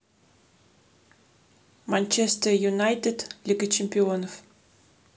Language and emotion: Russian, neutral